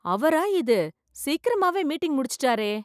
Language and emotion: Tamil, surprised